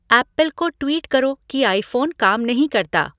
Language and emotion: Hindi, neutral